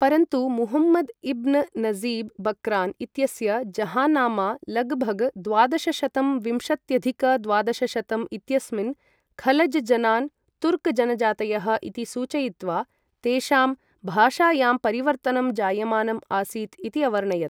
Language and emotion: Sanskrit, neutral